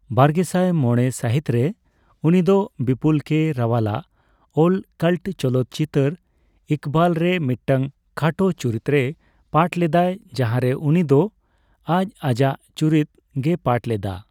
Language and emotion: Santali, neutral